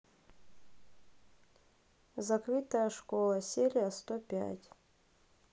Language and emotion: Russian, neutral